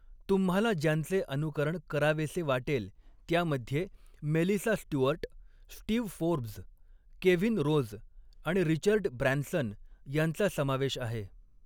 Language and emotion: Marathi, neutral